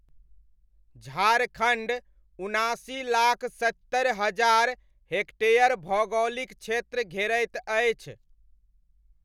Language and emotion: Maithili, neutral